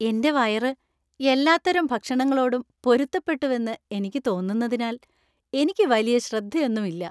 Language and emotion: Malayalam, happy